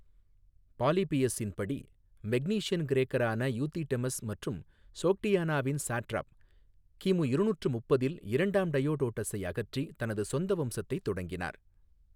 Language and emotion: Tamil, neutral